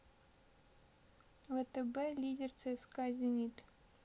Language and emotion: Russian, sad